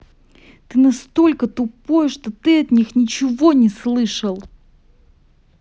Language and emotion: Russian, angry